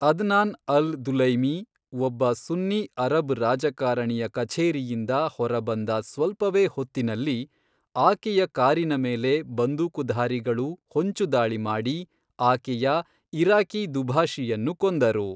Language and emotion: Kannada, neutral